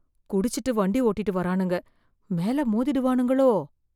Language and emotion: Tamil, fearful